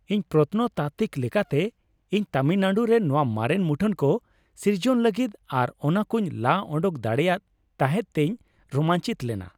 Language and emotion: Santali, happy